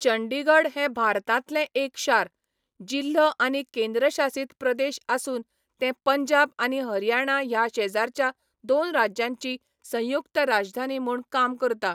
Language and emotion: Goan Konkani, neutral